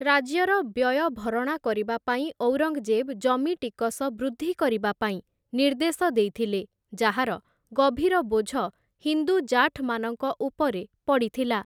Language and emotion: Odia, neutral